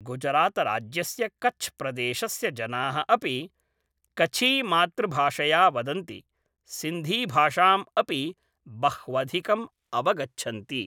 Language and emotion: Sanskrit, neutral